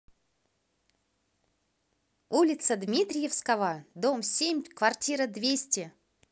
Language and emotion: Russian, positive